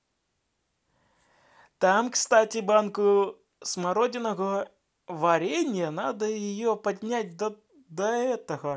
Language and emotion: Russian, positive